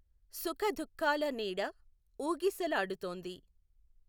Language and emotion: Telugu, neutral